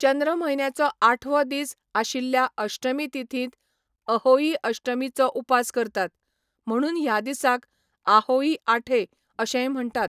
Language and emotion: Goan Konkani, neutral